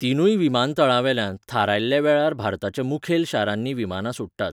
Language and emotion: Goan Konkani, neutral